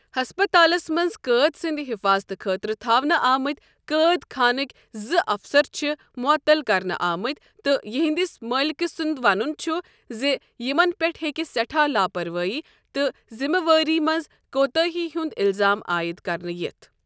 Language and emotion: Kashmiri, neutral